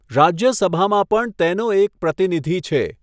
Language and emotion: Gujarati, neutral